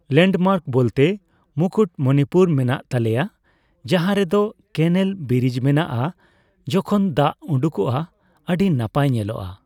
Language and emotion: Santali, neutral